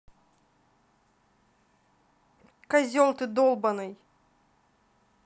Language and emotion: Russian, angry